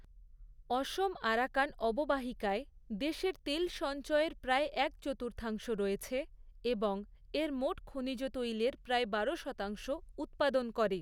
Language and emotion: Bengali, neutral